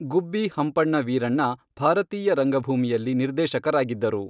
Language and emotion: Kannada, neutral